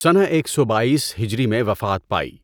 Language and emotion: Urdu, neutral